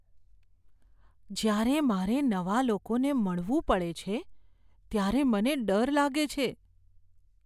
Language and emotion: Gujarati, fearful